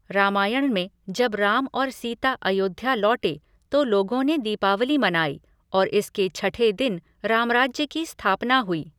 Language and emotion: Hindi, neutral